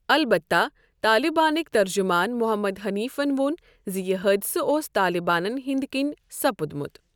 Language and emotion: Kashmiri, neutral